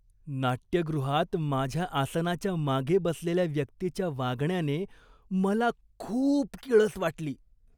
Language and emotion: Marathi, disgusted